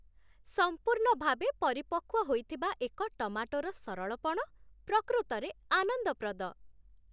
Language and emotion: Odia, happy